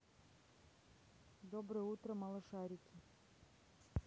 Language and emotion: Russian, neutral